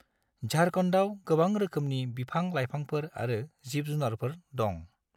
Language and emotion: Bodo, neutral